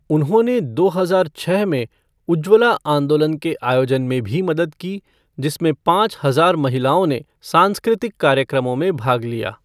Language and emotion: Hindi, neutral